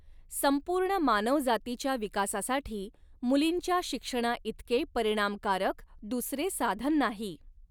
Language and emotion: Marathi, neutral